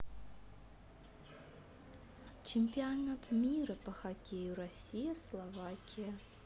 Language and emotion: Russian, neutral